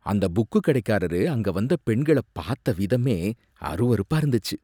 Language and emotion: Tamil, disgusted